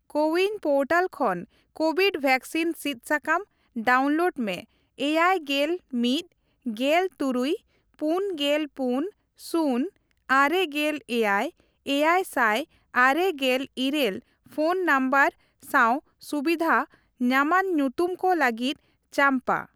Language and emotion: Santali, neutral